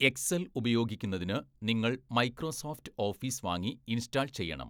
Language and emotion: Malayalam, neutral